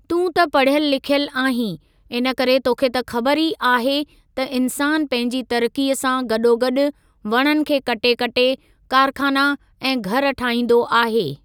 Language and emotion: Sindhi, neutral